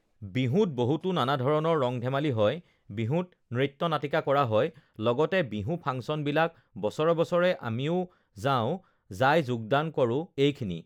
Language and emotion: Assamese, neutral